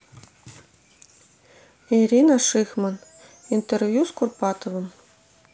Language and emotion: Russian, neutral